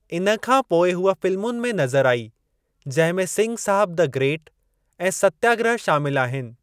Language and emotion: Sindhi, neutral